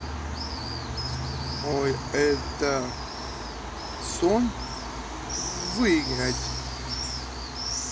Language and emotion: Russian, neutral